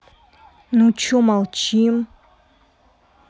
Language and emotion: Russian, angry